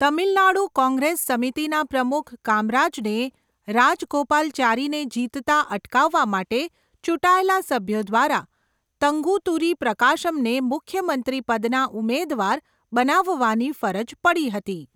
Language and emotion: Gujarati, neutral